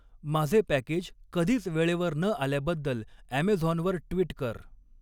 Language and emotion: Marathi, neutral